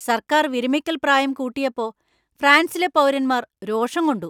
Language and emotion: Malayalam, angry